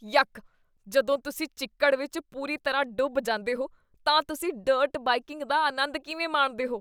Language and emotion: Punjabi, disgusted